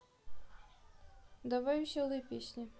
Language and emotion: Russian, neutral